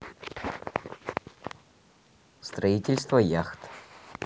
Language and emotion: Russian, neutral